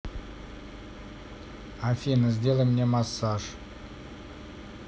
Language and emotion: Russian, neutral